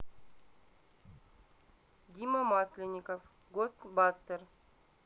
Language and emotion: Russian, neutral